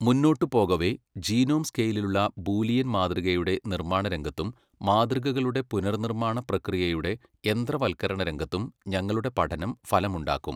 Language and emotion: Malayalam, neutral